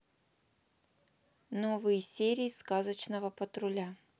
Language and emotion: Russian, neutral